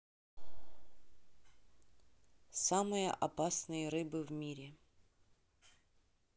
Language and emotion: Russian, neutral